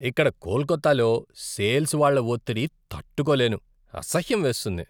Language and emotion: Telugu, disgusted